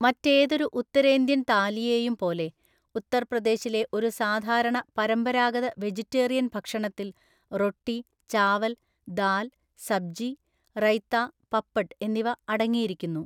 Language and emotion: Malayalam, neutral